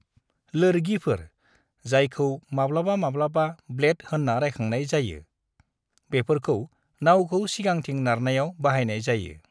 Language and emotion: Bodo, neutral